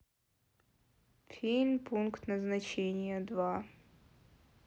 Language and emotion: Russian, sad